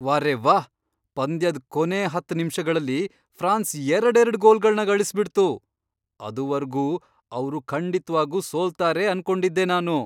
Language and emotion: Kannada, surprised